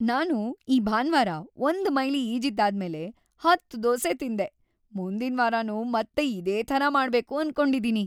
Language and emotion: Kannada, happy